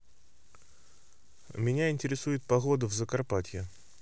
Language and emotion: Russian, neutral